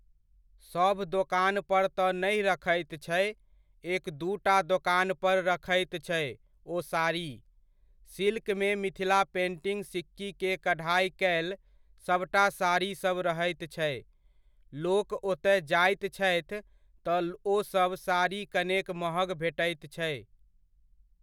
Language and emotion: Maithili, neutral